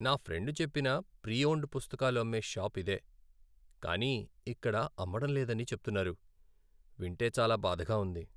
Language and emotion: Telugu, sad